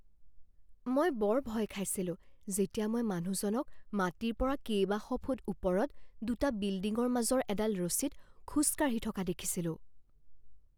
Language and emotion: Assamese, fearful